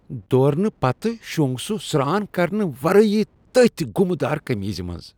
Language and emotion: Kashmiri, disgusted